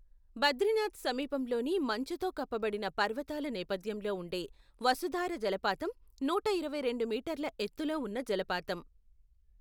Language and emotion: Telugu, neutral